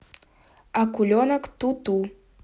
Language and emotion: Russian, neutral